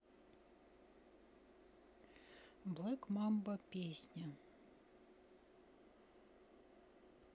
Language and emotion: Russian, neutral